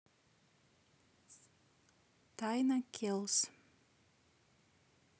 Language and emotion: Russian, neutral